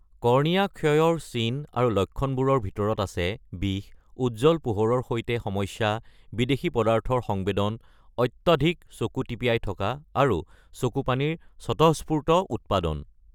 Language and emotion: Assamese, neutral